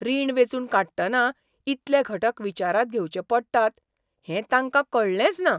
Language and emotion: Goan Konkani, surprised